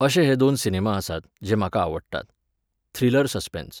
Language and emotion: Goan Konkani, neutral